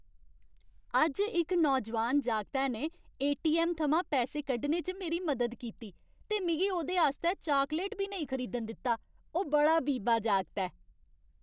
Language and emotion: Dogri, happy